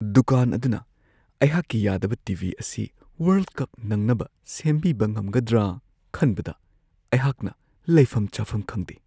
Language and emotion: Manipuri, fearful